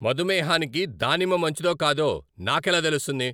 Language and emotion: Telugu, angry